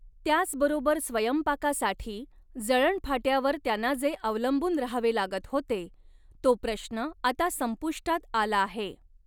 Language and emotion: Marathi, neutral